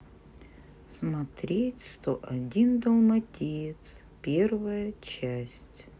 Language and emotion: Russian, neutral